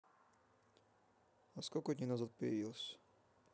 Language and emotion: Russian, neutral